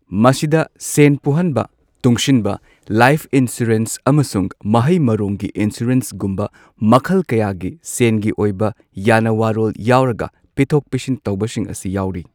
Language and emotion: Manipuri, neutral